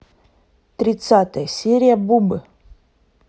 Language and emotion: Russian, neutral